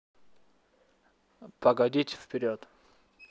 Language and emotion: Russian, neutral